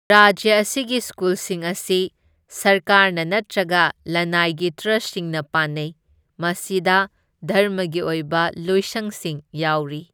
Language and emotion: Manipuri, neutral